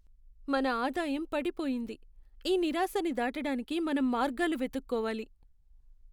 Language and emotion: Telugu, sad